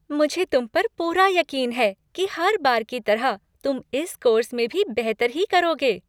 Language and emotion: Hindi, happy